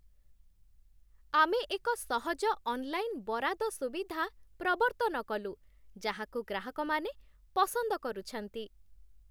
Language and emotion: Odia, happy